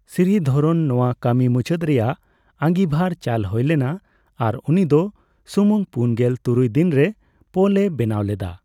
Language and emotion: Santali, neutral